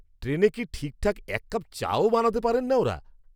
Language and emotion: Bengali, angry